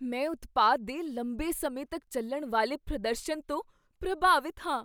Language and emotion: Punjabi, surprised